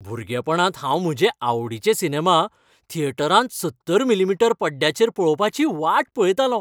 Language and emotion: Goan Konkani, happy